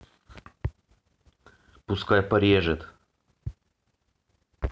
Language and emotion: Russian, neutral